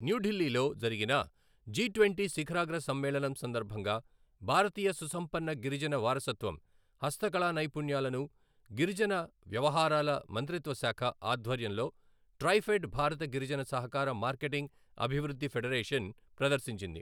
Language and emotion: Telugu, neutral